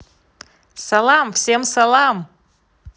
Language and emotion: Russian, positive